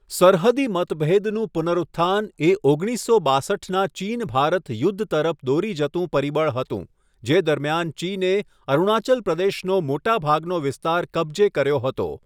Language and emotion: Gujarati, neutral